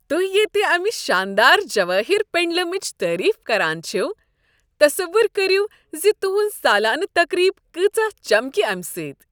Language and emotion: Kashmiri, happy